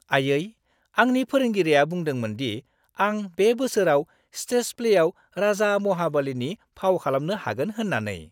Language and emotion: Bodo, happy